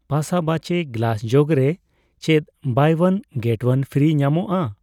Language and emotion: Santali, neutral